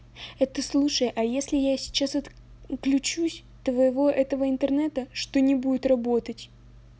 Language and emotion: Russian, angry